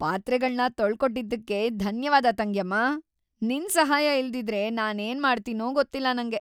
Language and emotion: Kannada, happy